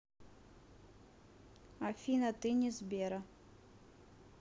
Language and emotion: Russian, neutral